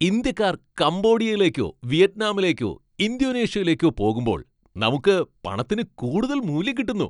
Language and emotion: Malayalam, happy